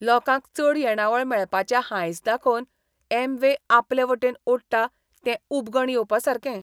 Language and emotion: Goan Konkani, disgusted